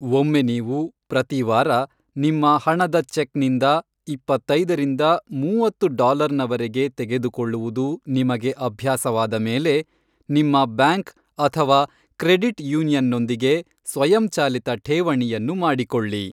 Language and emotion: Kannada, neutral